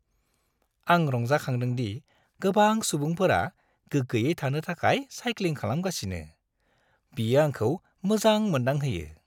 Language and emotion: Bodo, happy